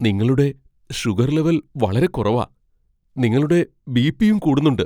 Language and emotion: Malayalam, fearful